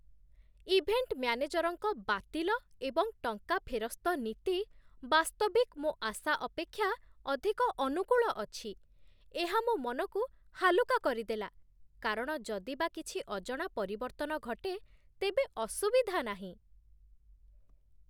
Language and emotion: Odia, surprised